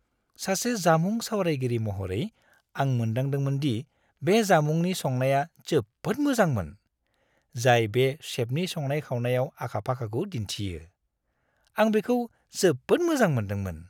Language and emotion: Bodo, happy